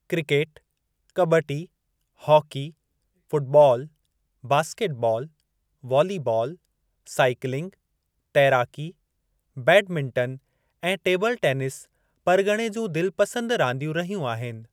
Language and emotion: Sindhi, neutral